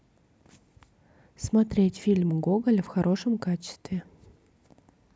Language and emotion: Russian, neutral